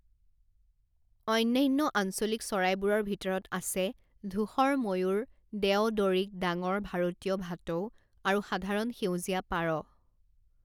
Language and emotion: Assamese, neutral